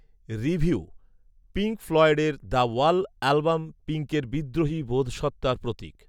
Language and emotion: Bengali, neutral